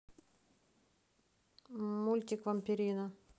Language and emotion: Russian, neutral